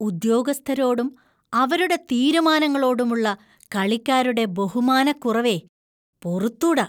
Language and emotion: Malayalam, disgusted